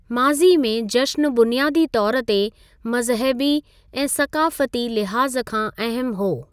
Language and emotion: Sindhi, neutral